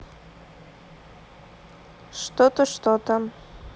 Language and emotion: Russian, neutral